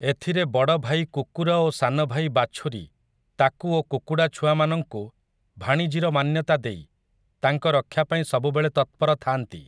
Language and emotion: Odia, neutral